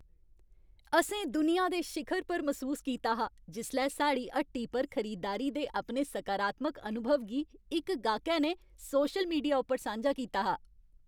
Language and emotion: Dogri, happy